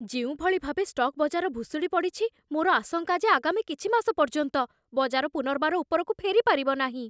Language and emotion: Odia, fearful